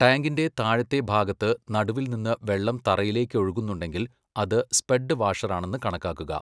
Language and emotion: Malayalam, neutral